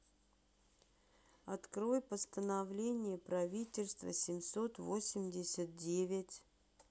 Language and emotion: Russian, neutral